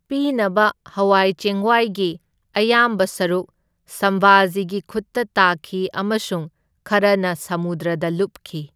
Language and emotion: Manipuri, neutral